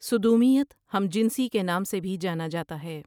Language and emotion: Urdu, neutral